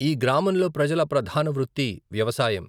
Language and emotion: Telugu, neutral